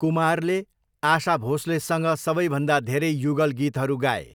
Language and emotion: Nepali, neutral